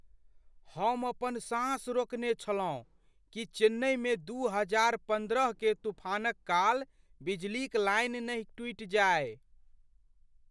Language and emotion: Maithili, fearful